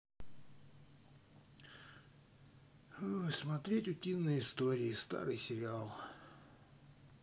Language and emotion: Russian, neutral